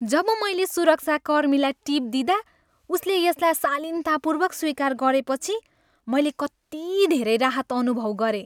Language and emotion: Nepali, happy